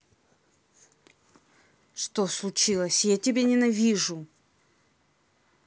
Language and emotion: Russian, angry